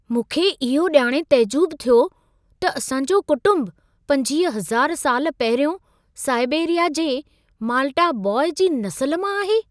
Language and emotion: Sindhi, surprised